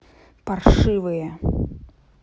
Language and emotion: Russian, angry